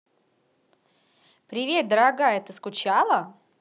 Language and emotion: Russian, positive